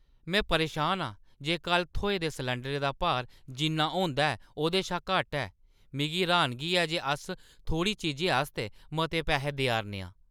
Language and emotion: Dogri, angry